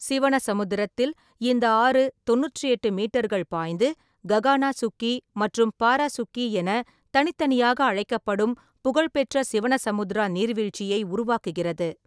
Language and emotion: Tamil, neutral